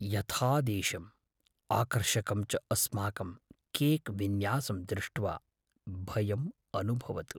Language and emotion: Sanskrit, fearful